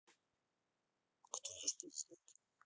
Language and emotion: Russian, neutral